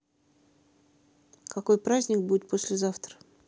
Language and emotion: Russian, neutral